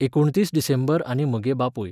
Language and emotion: Goan Konkani, neutral